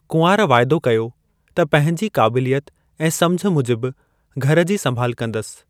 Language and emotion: Sindhi, neutral